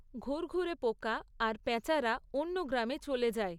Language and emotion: Bengali, neutral